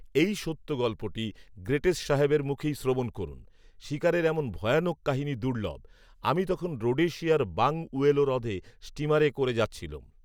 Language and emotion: Bengali, neutral